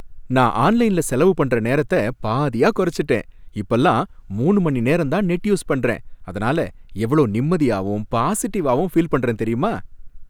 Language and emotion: Tamil, happy